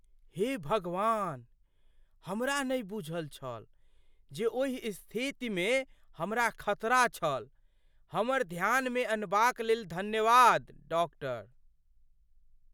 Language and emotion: Maithili, surprised